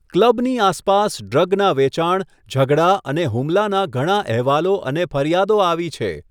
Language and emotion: Gujarati, neutral